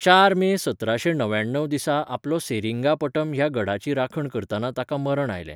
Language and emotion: Goan Konkani, neutral